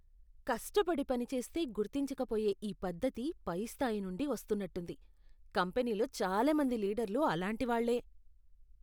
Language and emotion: Telugu, disgusted